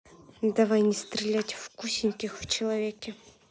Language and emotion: Russian, neutral